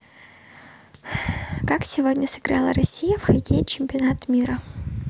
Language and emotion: Russian, neutral